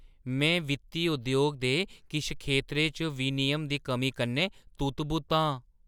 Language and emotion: Dogri, surprised